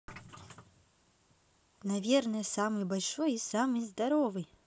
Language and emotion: Russian, positive